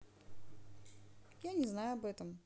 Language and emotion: Russian, neutral